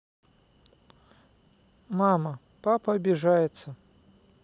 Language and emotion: Russian, neutral